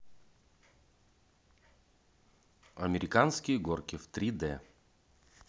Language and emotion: Russian, neutral